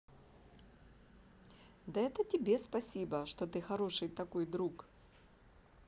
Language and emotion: Russian, positive